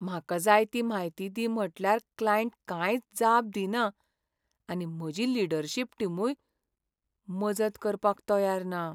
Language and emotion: Goan Konkani, sad